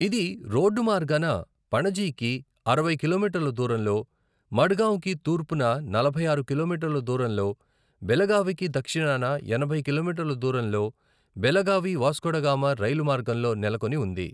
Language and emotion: Telugu, neutral